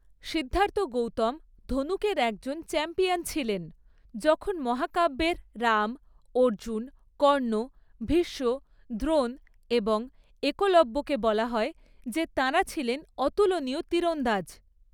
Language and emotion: Bengali, neutral